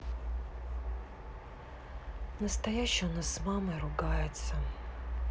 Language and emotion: Russian, sad